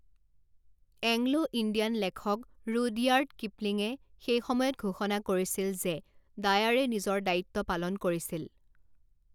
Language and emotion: Assamese, neutral